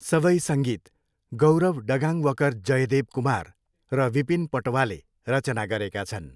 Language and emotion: Nepali, neutral